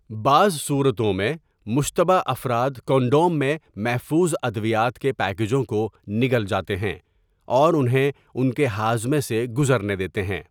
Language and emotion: Urdu, neutral